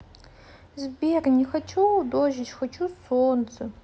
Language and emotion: Russian, sad